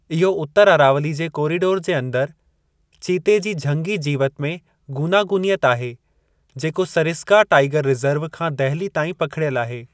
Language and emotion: Sindhi, neutral